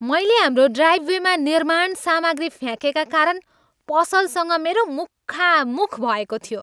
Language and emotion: Nepali, angry